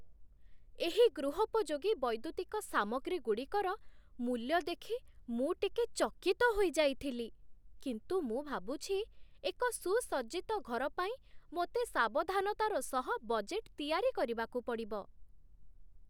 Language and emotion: Odia, surprised